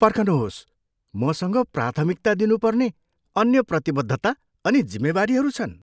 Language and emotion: Nepali, surprised